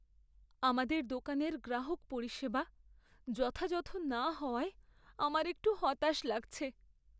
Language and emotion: Bengali, sad